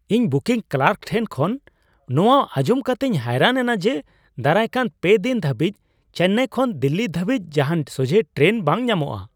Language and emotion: Santali, surprised